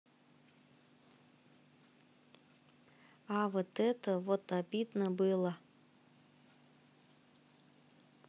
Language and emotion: Russian, neutral